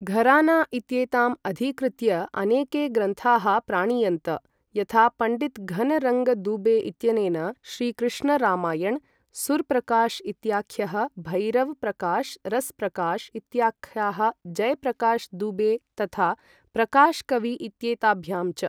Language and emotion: Sanskrit, neutral